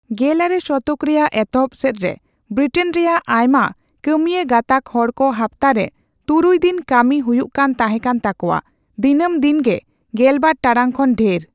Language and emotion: Santali, neutral